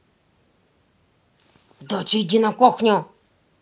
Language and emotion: Russian, angry